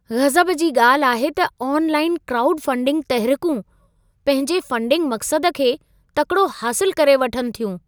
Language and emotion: Sindhi, surprised